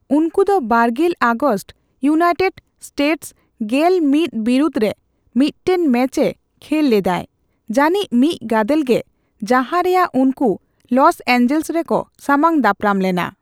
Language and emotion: Santali, neutral